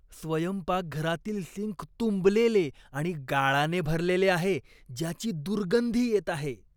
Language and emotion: Marathi, disgusted